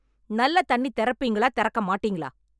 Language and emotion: Tamil, angry